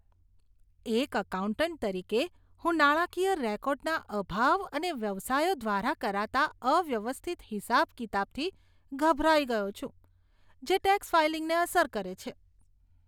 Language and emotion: Gujarati, disgusted